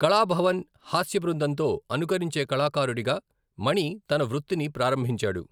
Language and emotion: Telugu, neutral